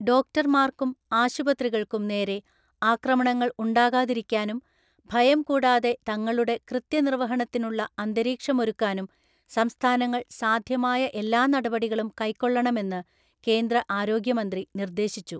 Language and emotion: Malayalam, neutral